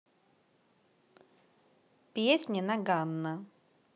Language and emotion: Russian, neutral